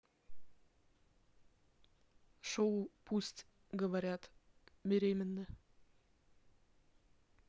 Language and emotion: Russian, neutral